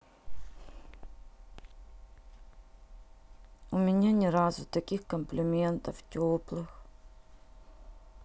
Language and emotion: Russian, sad